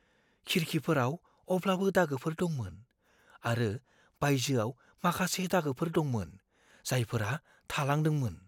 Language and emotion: Bodo, fearful